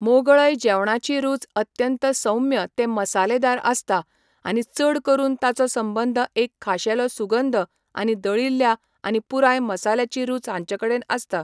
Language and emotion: Goan Konkani, neutral